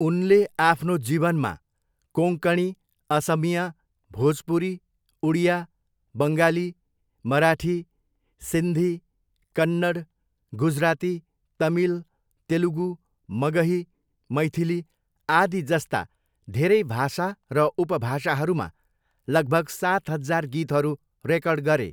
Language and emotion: Nepali, neutral